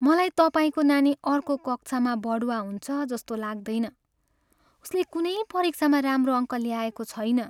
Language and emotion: Nepali, sad